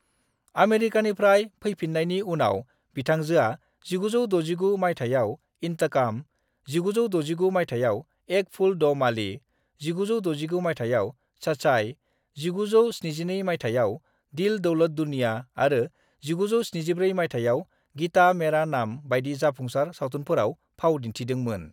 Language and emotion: Bodo, neutral